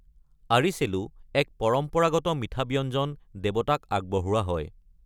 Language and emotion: Assamese, neutral